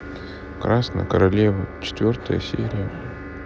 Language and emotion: Russian, sad